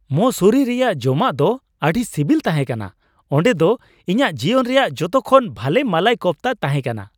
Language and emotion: Santali, happy